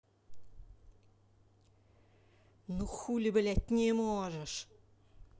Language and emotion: Russian, angry